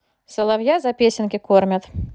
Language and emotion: Russian, neutral